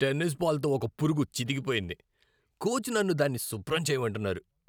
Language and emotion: Telugu, disgusted